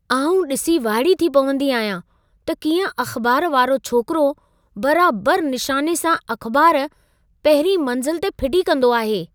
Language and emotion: Sindhi, surprised